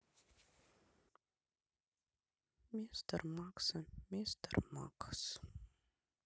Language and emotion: Russian, sad